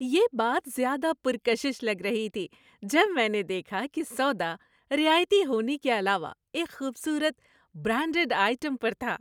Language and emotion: Urdu, happy